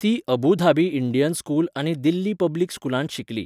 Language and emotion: Goan Konkani, neutral